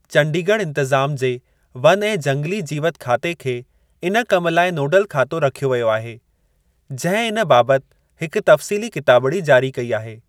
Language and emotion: Sindhi, neutral